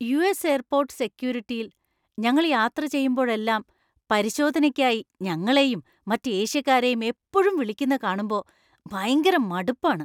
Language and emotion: Malayalam, disgusted